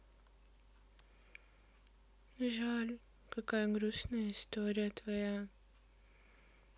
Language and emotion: Russian, sad